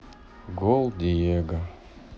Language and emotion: Russian, sad